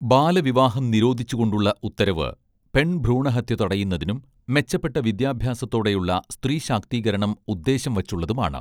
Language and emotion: Malayalam, neutral